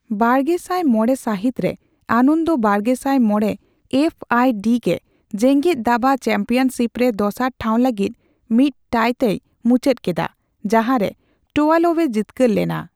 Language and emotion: Santali, neutral